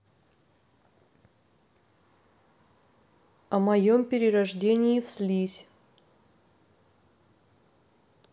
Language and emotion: Russian, neutral